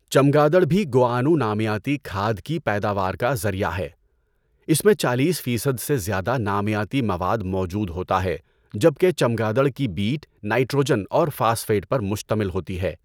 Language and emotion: Urdu, neutral